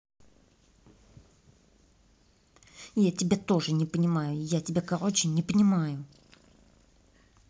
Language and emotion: Russian, angry